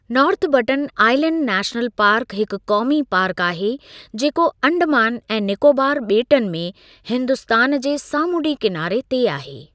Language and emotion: Sindhi, neutral